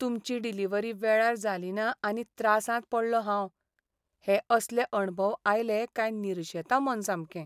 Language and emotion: Goan Konkani, sad